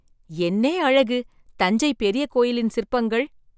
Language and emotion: Tamil, surprised